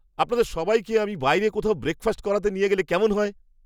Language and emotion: Bengali, surprised